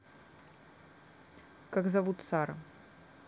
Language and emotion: Russian, neutral